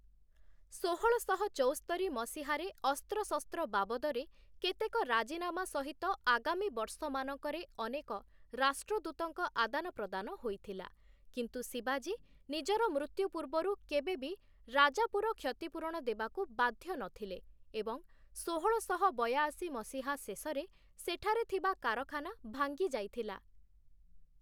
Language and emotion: Odia, neutral